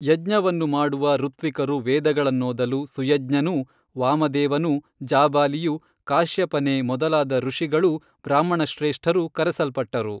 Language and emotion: Kannada, neutral